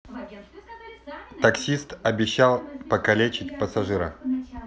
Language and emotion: Russian, neutral